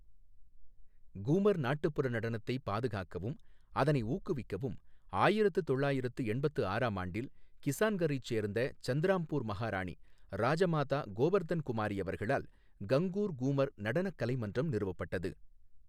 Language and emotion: Tamil, neutral